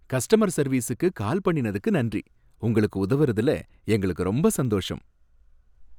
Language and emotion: Tamil, happy